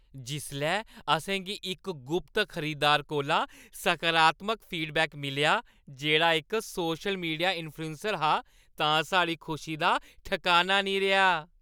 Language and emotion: Dogri, happy